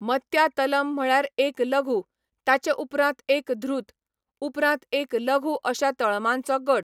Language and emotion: Goan Konkani, neutral